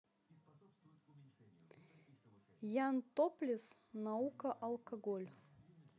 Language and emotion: Russian, neutral